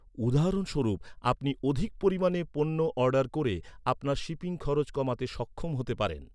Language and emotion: Bengali, neutral